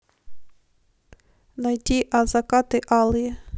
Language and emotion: Russian, neutral